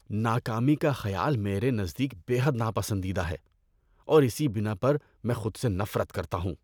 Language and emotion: Urdu, disgusted